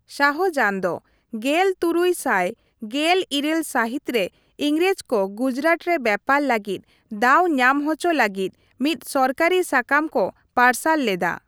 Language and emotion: Santali, neutral